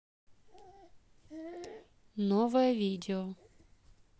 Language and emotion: Russian, neutral